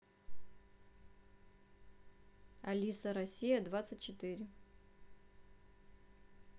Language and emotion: Russian, neutral